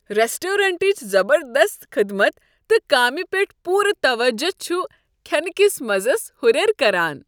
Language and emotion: Kashmiri, happy